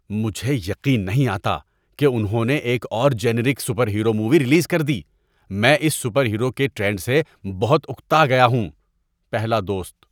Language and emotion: Urdu, disgusted